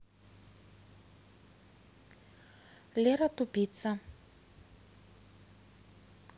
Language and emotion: Russian, neutral